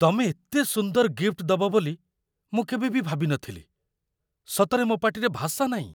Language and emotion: Odia, surprised